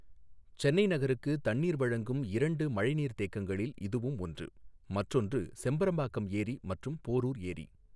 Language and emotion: Tamil, neutral